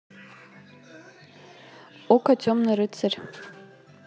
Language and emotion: Russian, neutral